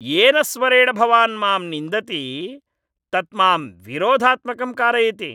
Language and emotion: Sanskrit, angry